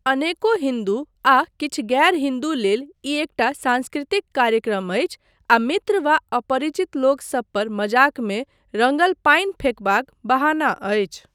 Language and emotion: Maithili, neutral